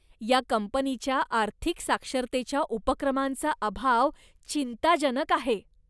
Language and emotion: Marathi, disgusted